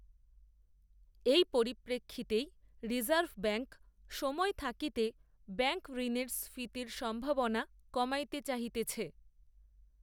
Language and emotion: Bengali, neutral